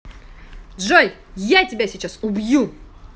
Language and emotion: Russian, angry